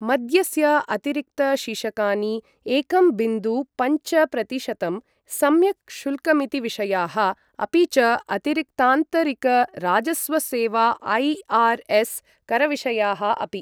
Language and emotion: Sanskrit, neutral